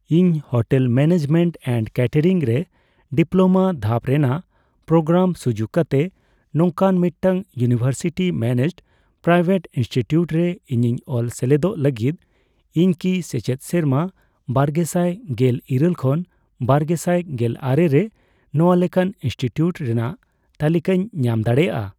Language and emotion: Santali, neutral